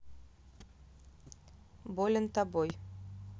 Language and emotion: Russian, neutral